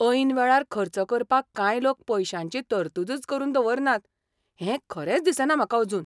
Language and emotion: Goan Konkani, surprised